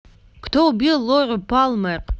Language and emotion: Russian, neutral